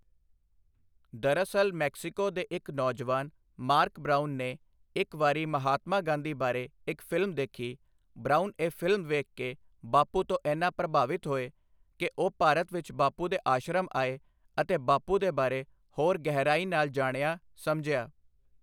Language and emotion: Punjabi, neutral